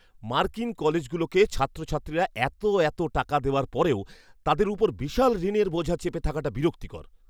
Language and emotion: Bengali, angry